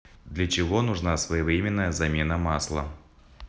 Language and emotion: Russian, neutral